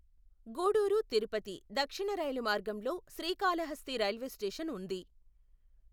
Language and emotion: Telugu, neutral